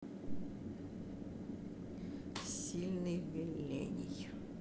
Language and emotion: Russian, neutral